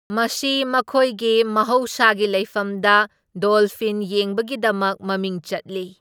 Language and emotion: Manipuri, neutral